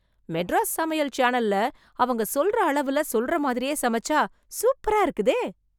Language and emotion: Tamil, surprised